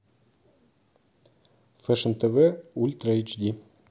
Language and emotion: Russian, neutral